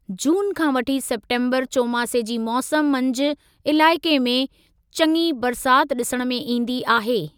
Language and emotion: Sindhi, neutral